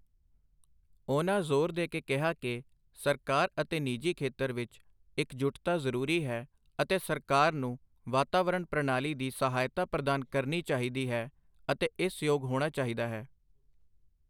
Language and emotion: Punjabi, neutral